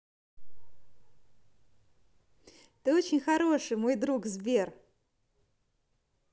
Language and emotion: Russian, positive